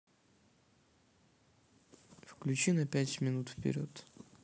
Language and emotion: Russian, neutral